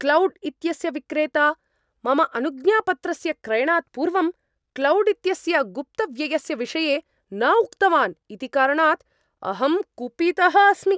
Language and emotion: Sanskrit, angry